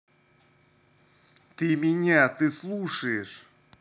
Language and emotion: Russian, angry